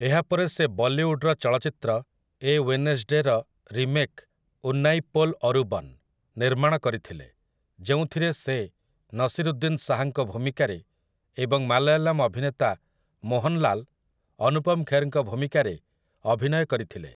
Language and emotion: Odia, neutral